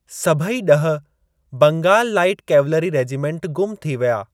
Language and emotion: Sindhi, neutral